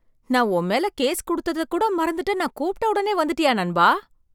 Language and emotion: Tamil, surprised